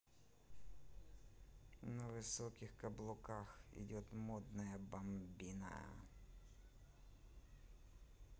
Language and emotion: Russian, neutral